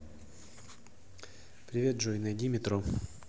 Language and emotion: Russian, neutral